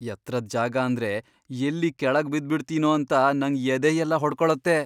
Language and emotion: Kannada, fearful